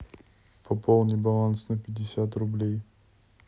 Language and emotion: Russian, neutral